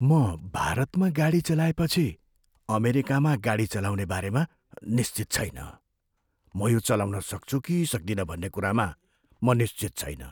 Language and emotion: Nepali, fearful